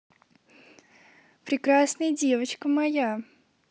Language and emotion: Russian, positive